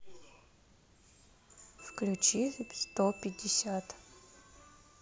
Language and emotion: Russian, neutral